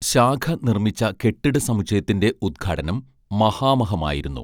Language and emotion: Malayalam, neutral